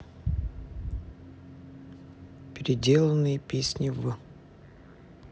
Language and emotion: Russian, neutral